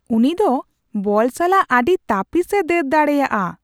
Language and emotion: Santali, surprised